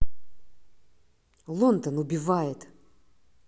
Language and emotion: Russian, angry